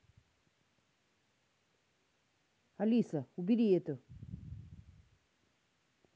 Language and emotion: Russian, angry